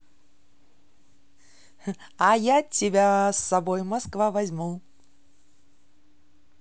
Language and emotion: Russian, positive